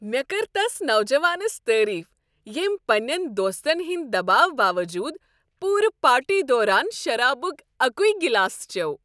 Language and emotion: Kashmiri, happy